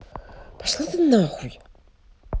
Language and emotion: Russian, angry